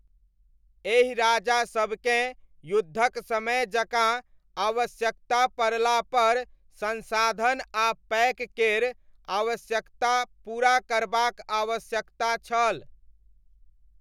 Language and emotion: Maithili, neutral